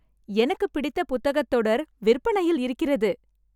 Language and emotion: Tamil, happy